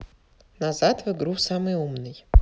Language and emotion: Russian, neutral